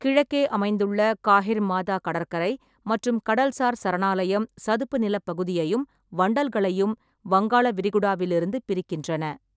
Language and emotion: Tamil, neutral